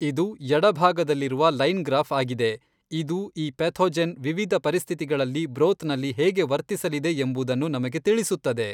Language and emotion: Kannada, neutral